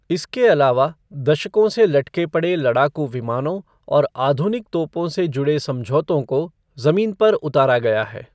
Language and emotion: Hindi, neutral